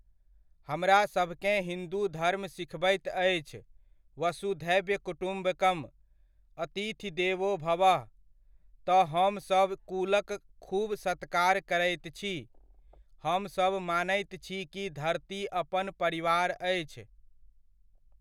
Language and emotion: Maithili, neutral